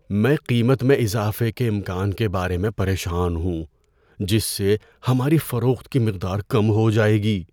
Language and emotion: Urdu, fearful